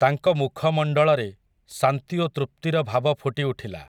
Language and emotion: Odia, neutral